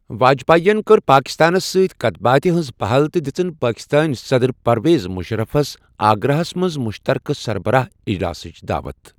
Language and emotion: Kashmiri, neutral